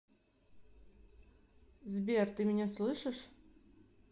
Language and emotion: Russian, neutral